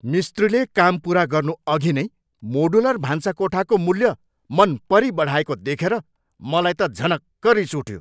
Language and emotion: Nepali, angry